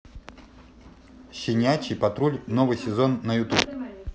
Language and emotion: Russian, neutral